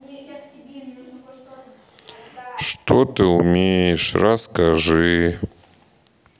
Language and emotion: Russian, sad